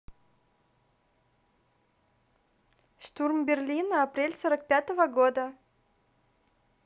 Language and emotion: Russian, neutral